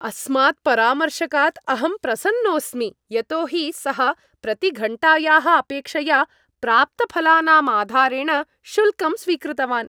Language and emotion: Sanskrit, happy